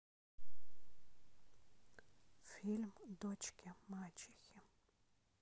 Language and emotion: Russian, neutral